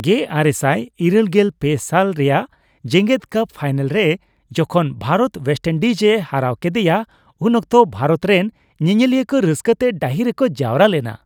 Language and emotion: Santali, happy